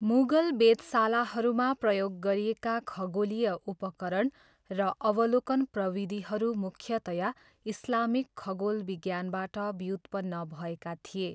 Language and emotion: Nepali, neutral